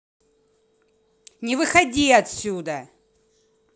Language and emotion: Russian, angry